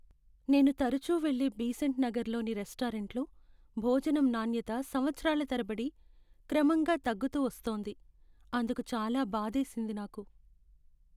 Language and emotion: Telugu, sad